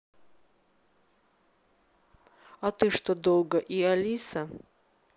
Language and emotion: Russian, neutral